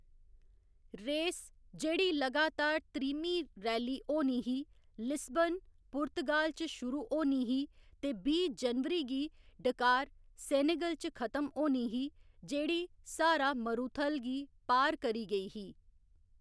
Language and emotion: Dogri, neutral